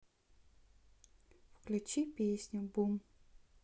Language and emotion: Russian, neutral